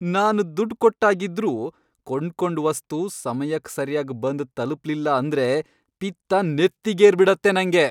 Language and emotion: Kannada, angry